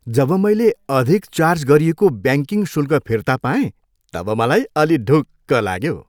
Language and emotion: Nepali, happy